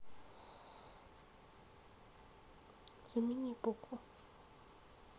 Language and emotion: Russian, neutral